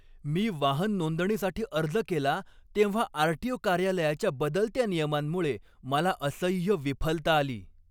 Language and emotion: Marathi, angry